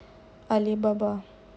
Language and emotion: Russian, neutral